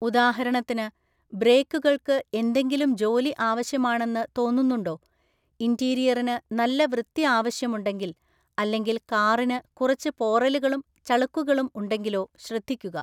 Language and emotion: Malayalam, neutral